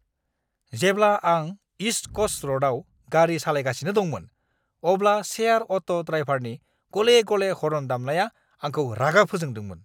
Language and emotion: Bodo, angry